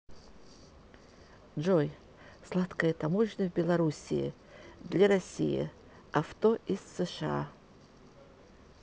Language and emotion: Russian, neutral